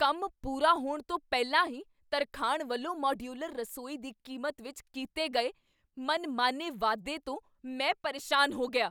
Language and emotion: Punjabi, angry